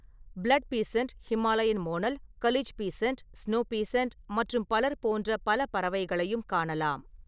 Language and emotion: Tamil, neutral